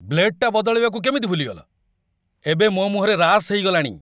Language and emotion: Odia, angry